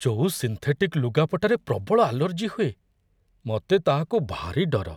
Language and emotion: Odia, fearful